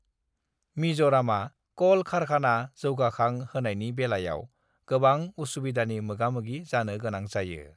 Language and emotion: Bodo, neutral